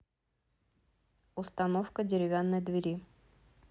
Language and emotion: Russian, neutral